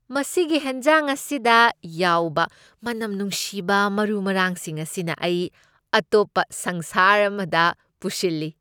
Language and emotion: Manipuri, happy